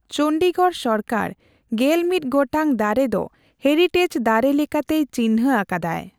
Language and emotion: Santali, neutral